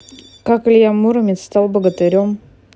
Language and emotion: Russian, neutral